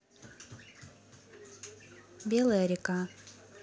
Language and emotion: Russian, neutral